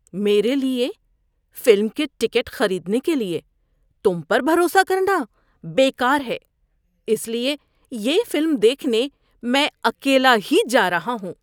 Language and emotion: Urdu, disgusted